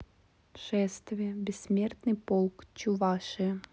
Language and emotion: Russian, neutral